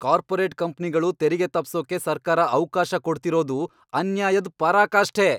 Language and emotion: Kannada, angry